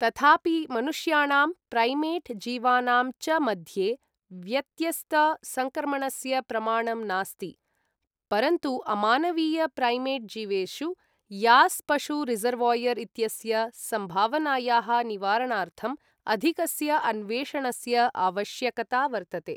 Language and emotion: Sanskrit, neutral